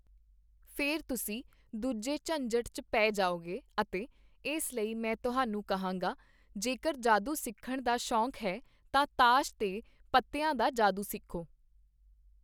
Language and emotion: Punjabi, neutral